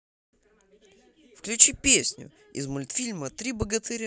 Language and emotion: Russian, positive